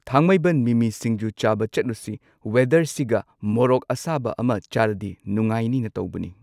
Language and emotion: Manipuri, neutral